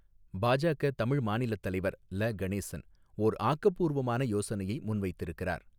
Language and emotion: Tamil, neutral